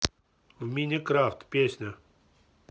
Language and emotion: Russian, neutral